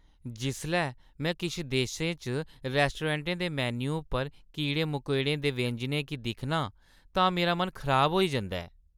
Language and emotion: Dogri, disgusted